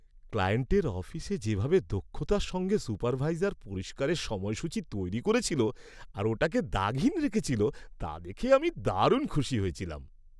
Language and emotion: Bengali, happy